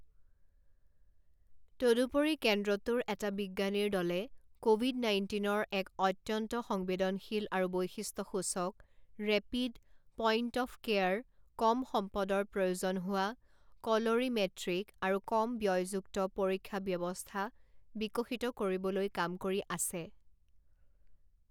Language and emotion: Assamese, neutral